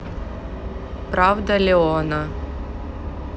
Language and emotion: Russian, neutral